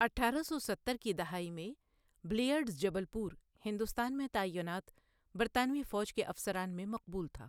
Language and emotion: Urdu, neutral